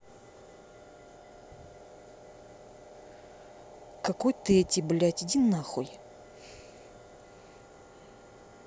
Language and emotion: Russian, angry